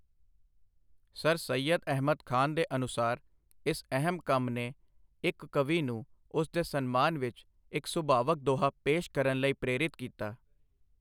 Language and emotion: Punjabi, neutral